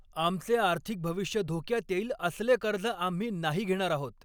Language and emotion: Marathi, angry